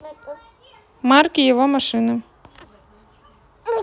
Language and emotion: Russian, neutral